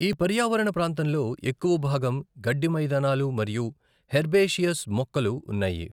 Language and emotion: Telugu, neutral